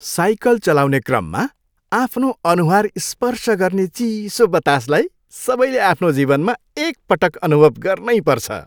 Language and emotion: Nepali, happy